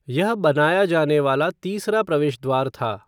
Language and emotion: Hindi, neutral